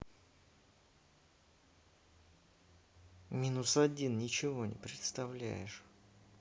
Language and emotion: Russian, angry